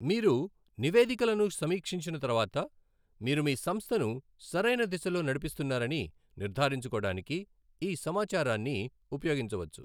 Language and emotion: Telugu, neutral